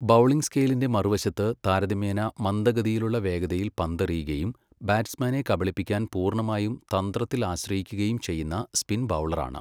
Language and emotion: Malayalam, neutral